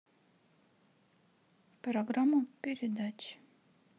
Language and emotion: Russian, neutral